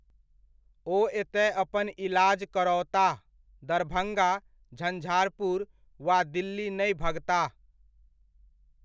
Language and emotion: Maithili, neutral